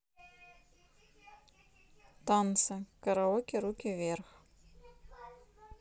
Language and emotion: Russian, neutral